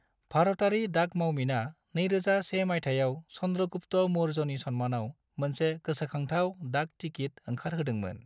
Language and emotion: Bodo, neutral